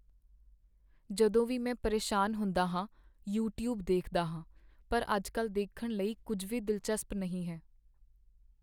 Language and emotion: Punjabi, sad